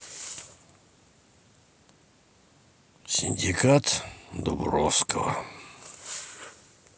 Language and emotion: Russian, sad